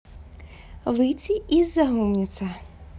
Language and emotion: Russian, positive